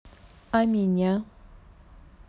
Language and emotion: Russian, neutral